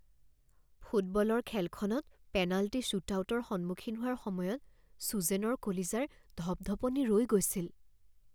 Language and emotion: Assamese, fearful